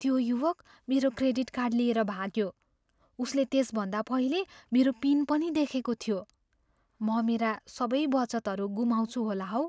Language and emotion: Nepali, fearful